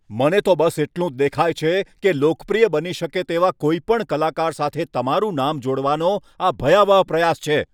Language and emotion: Gujarati, angry